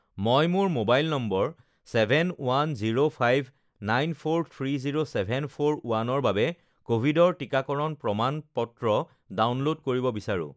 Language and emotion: Assamese, neutral